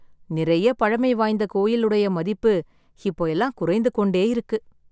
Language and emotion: Tamil, sad